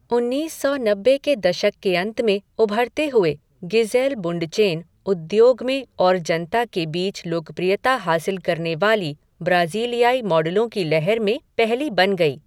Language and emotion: Hindi, neutral